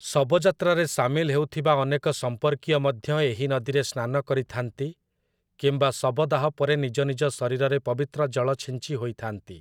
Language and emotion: Odia, neutral